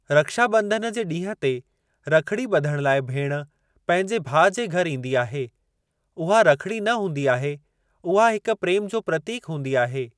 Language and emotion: Sindhi, neutral